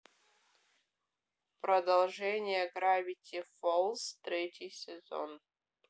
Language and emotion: Russian, neutral